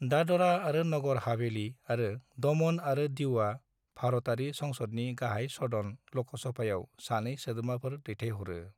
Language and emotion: Bodo, neutral